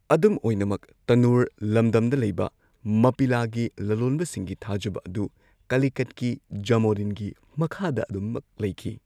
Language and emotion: Manipuri, neutral